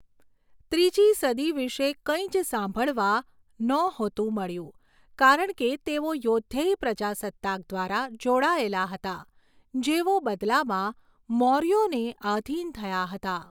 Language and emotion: Gujarati, neutral